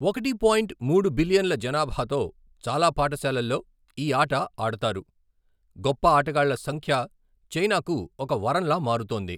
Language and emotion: Telugu, neutral